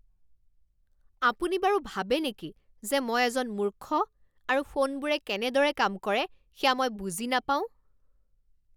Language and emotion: Assamese, angry